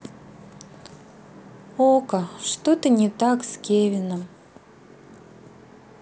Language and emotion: Russian, sad